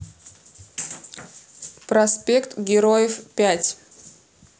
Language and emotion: Russian, neutral